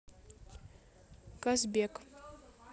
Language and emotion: Russian, neutral